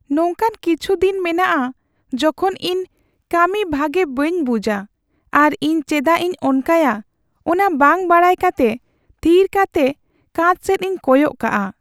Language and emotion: Santali, sad